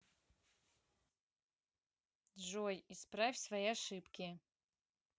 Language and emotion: Russian, neutral